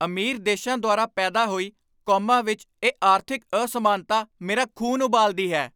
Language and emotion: Punjabi, angry